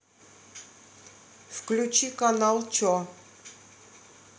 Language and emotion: Russian, neutral